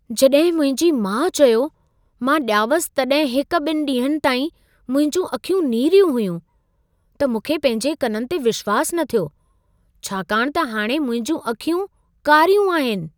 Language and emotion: Sindhi, surprised